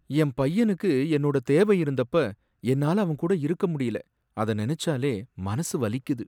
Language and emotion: Tamil, sad